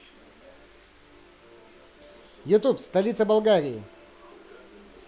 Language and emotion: Russian, positive